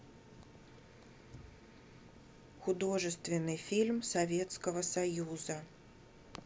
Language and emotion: Russian, neutral